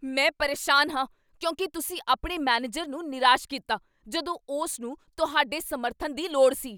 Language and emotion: Punjabi, angry